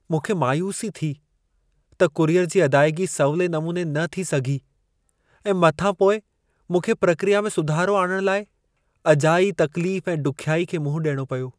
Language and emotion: Sindhi, sad